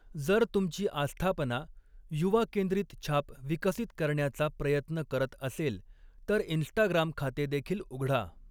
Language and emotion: Marathi, neutral